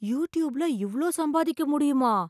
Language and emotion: Tamil, surprised